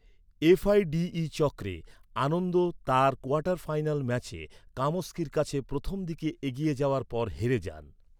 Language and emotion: Bengali, neutral